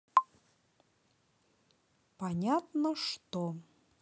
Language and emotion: Russian, neutral